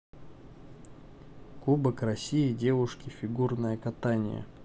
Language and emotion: Russian, neutral